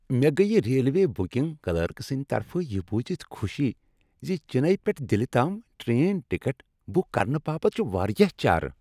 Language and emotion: Kashmiri, happy